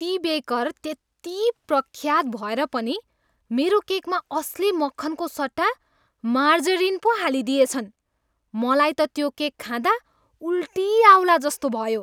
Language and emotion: Nepali, disgusted